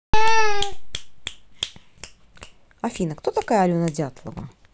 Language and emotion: Russian, neutral